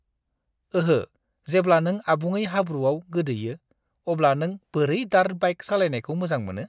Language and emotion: Bodo, disgusted